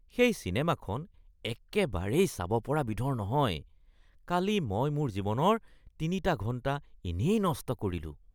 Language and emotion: Assamese, disgusted